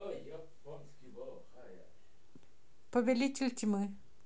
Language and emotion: Russian, neutral